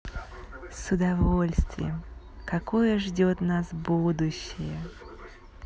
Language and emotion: Russian, positive